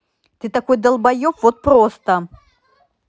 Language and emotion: Russian, angry